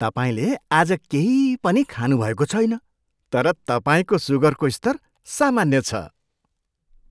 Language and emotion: Nepali, surprised